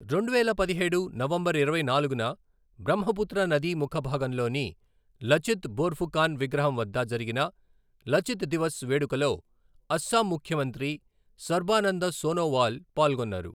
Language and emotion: Telugu, neutral